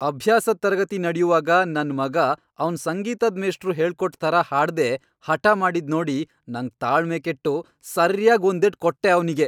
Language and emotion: Kannada, angry